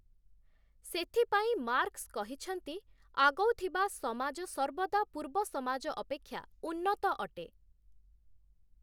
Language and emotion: Odia, neutral